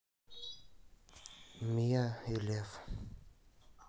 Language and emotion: Russian, sad